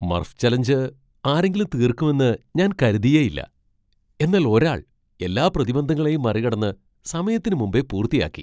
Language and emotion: Malayalam, surprised